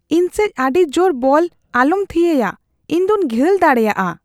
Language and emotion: Santali, fearful